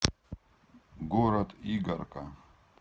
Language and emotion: Russian, neutral